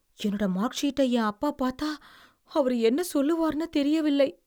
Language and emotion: Tamil, fearful